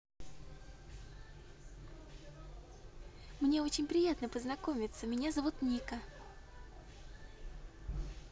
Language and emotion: Russian, positive